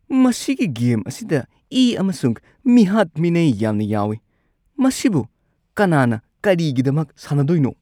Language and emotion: Manipuri, disgusted